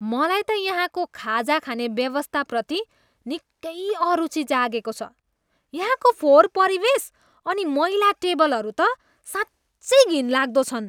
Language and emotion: Nepali, disgusted